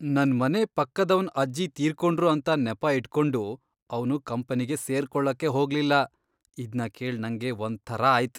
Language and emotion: Kannada, disgusted